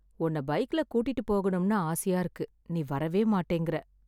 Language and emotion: Tamil, sad